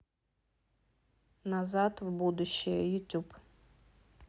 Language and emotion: Russian, neutral